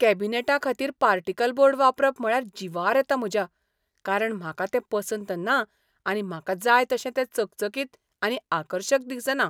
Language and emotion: Goan Konkani, disgusted